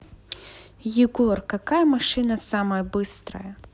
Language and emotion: Russian, neutral